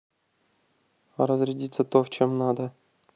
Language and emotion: Russian, neutral